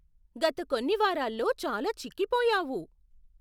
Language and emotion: Telugu, surprised